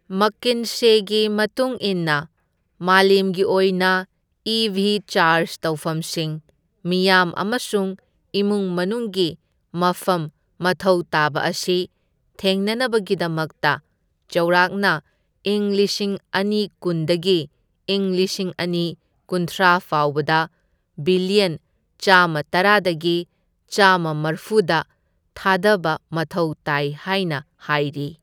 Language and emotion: Manipuri, neutral